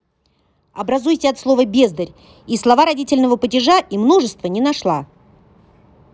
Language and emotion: Russian, angry